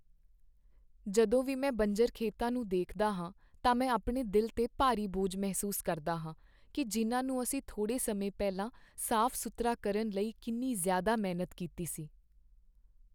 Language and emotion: Punjabi, sad